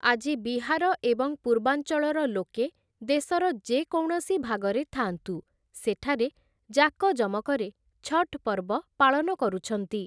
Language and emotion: Odia, neutral